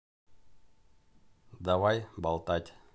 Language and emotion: Russian, neutral